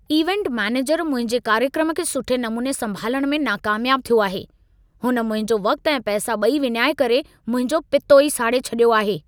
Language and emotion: Sindhi, angry